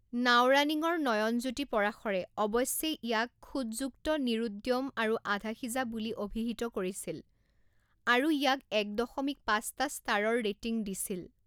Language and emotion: Assamese, neutral